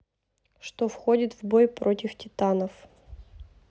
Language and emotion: Russian, neutral